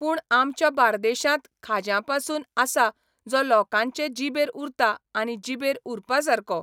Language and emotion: Goan Konkani, neutral